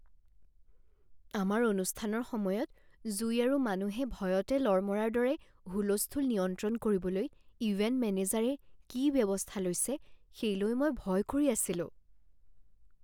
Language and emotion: Assamese, fearful